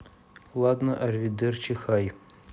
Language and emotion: Russian, neutral